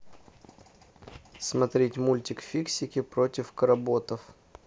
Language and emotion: Russian, neutral